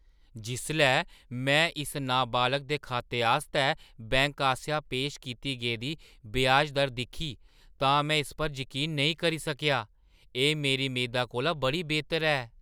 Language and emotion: Dogri, surprised